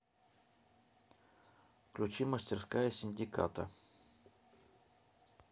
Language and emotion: Russian, neutral